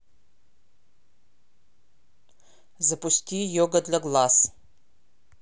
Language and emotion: Russian, neutral